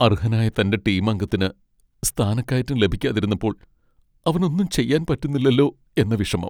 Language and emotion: Malayalam, sad